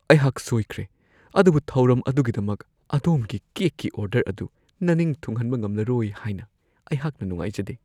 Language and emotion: Manipuri, fearful